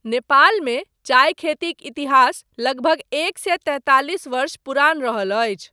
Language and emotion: Maithili, neutral